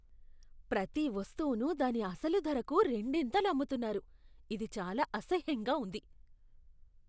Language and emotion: Telugu, disgusted